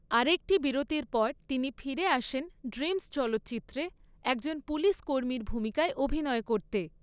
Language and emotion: Bengali, neutral